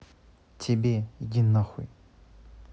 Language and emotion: Russian, angry